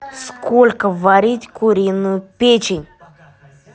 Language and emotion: Russian, angry